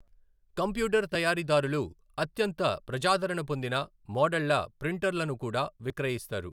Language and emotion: Telugu, neutral